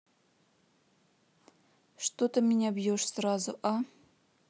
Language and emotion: Russian, sad